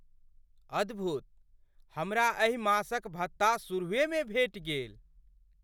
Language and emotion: Maithili, surprised